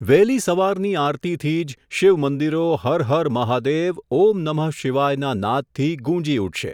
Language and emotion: Gujarati, neutral